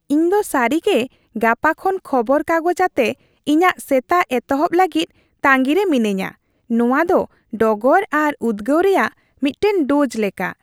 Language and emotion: Santali, happy